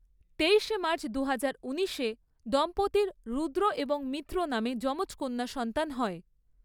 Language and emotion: Bengali, neutral